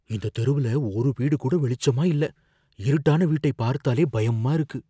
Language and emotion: Tamil, fearful